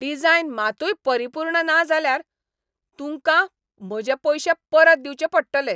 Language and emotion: Goan Konkani, angry